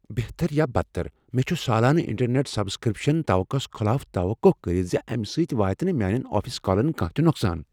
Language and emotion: Kashmiri, fearful